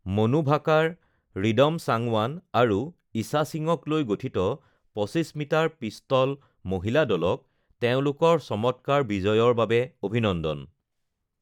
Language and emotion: Assamese, neutral